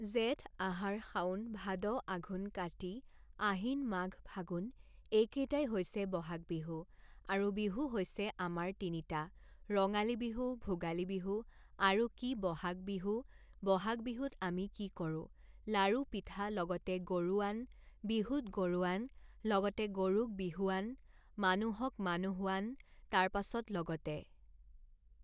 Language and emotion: Assamese, neutral